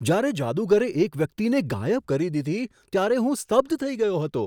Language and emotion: Gujarati, surprised